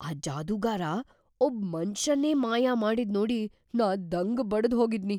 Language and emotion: Kannada, surprised